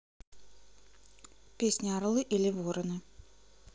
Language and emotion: Russian, neutral